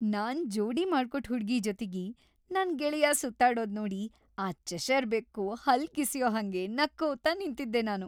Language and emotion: Kannada, happy